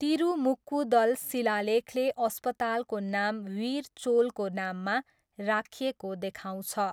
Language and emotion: Nepali, neutral